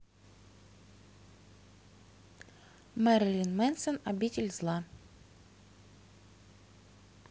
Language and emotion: Russian, neutral